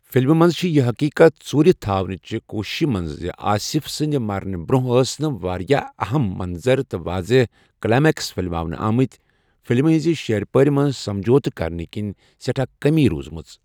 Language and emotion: Kashmiri, neutral